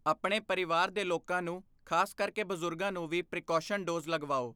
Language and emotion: Punjabi, neutral